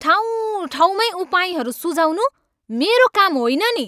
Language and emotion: Nepali, angry